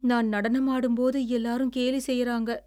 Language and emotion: Tamil, sad